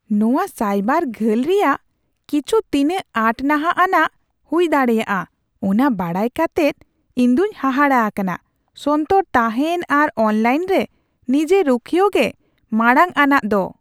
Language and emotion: Santali, surprised